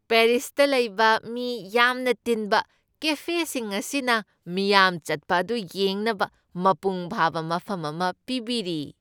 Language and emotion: Manipuri, happy